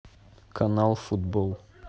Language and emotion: Russian, neutral